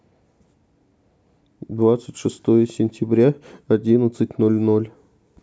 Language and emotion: Russian, neutral